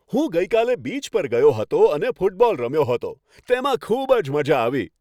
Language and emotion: Gujarati, happy